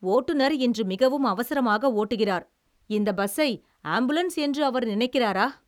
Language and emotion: Tamil, angry